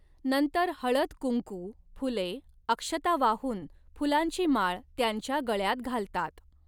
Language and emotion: Marathi, neutral